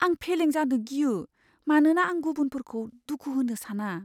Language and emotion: Bodo, fearful